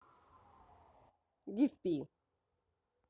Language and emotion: Russian, angry